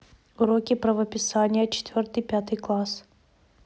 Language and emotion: Russian, neutral